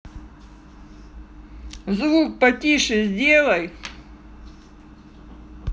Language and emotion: Russian, angry